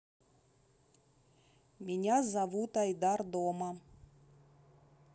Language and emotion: Russian, neutral